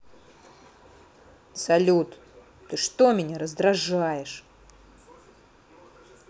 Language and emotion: Russian, angry